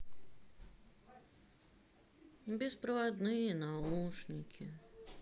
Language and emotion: Russian, sad